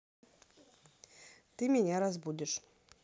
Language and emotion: Russian, neutral